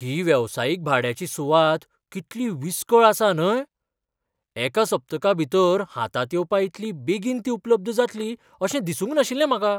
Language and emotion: Goan Konkani, surprised